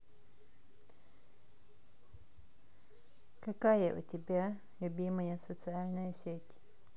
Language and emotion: Russian, neutral